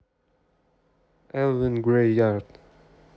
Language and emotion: Russian, neutral